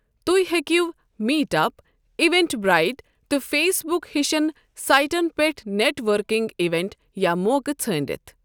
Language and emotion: Kashmiri, neutral